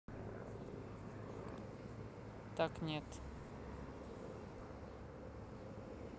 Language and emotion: Russian, neutral